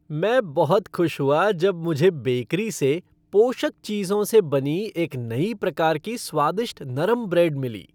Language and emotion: Hindi, happy